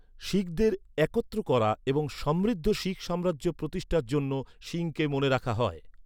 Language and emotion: Bengali, neutral